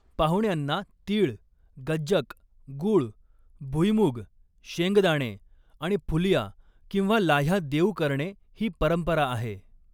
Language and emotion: Marathi, neutral